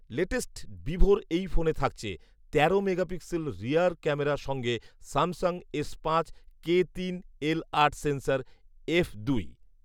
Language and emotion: Bengali, neutral